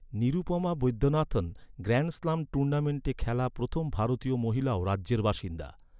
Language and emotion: Bengali, neutral